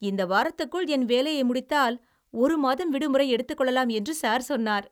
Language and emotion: Tamil, happy